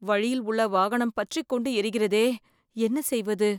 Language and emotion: Tamil, fearful